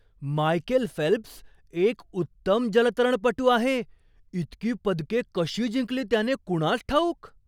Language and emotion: Marathi, surprised